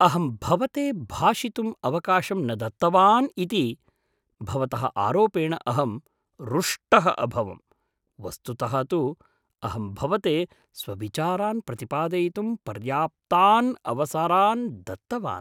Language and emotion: Sanskrit, surprised